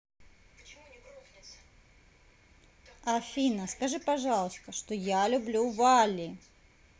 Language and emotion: Russian, neutral